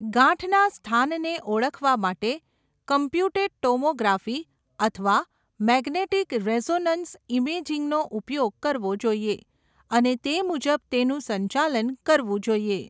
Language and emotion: Gujarati, neutral